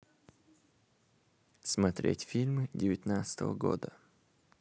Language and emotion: Russian, neutral